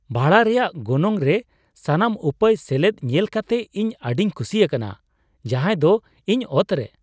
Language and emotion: Santali, surprised